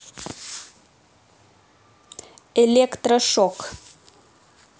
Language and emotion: Russian, neutral